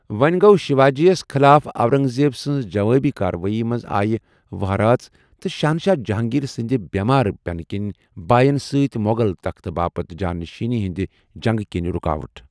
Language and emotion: Kashmiri, neutral